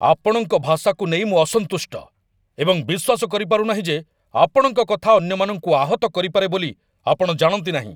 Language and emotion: Odia, angry